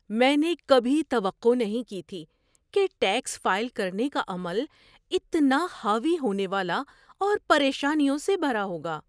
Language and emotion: Urdu, surprised